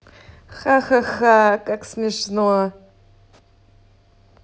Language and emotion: Russian, angry